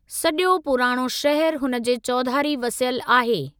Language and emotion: Sindhi, neutral